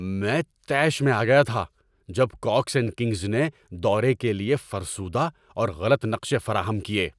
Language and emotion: Urdu, angry